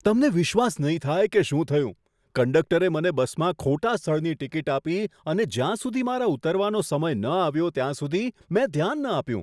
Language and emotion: Gujarati, surprised